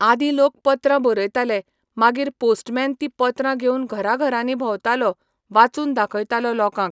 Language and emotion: Goan Konkani, neutral